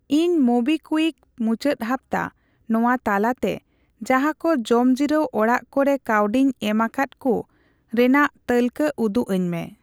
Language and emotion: Santali, neutral